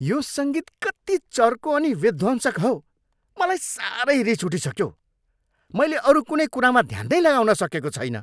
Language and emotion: Nepali, angry